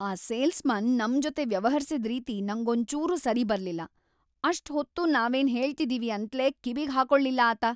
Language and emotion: Kannada, angry